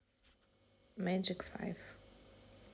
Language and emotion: Russian, neutral